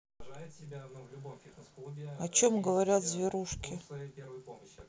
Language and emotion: Russian, neutral